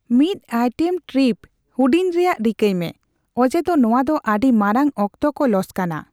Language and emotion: Santali, neutral